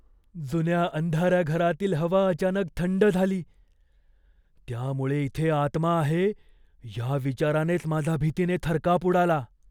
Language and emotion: Marathi, fearful